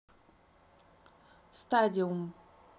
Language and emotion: Russian, neutral